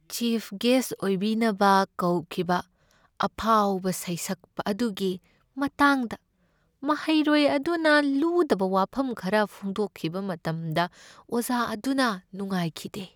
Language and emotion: Manipuri, sad